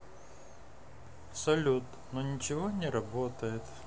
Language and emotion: Russian, sad